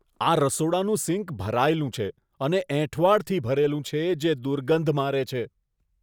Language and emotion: Gujarati, disgusted